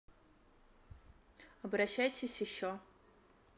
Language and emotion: Russian, neutral